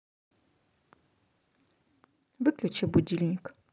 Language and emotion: Russian, neutral